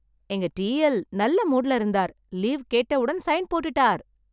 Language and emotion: Tamil, happy